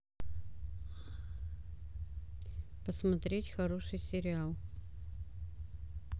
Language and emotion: Russian, neutral